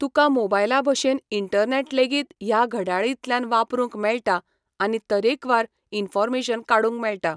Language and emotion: Goan Konkani, neutral